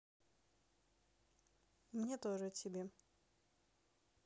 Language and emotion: Russian, neutral